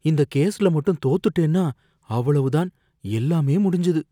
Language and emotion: Tamil, fearful